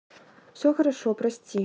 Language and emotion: Russian, neutral